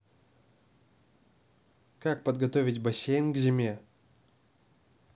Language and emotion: Russian, neutral